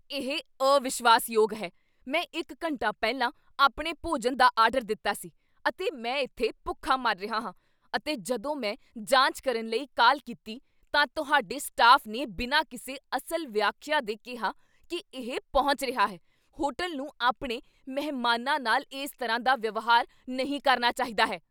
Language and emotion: Punjabi, angry